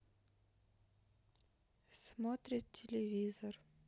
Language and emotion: Russian, neutral